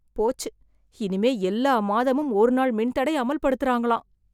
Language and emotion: Tamil, fearful